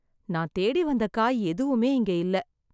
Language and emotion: Tamil, sad